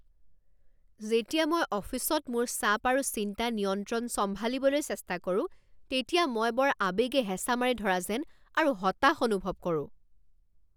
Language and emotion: Assamese, angry